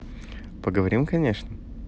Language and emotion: Russian, positive